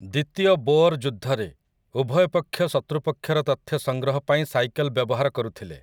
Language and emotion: Odia, neutral